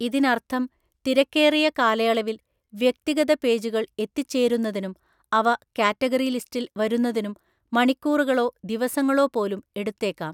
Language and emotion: Malayalam, neutral